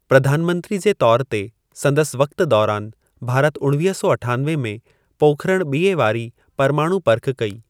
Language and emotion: Sindhi, neutral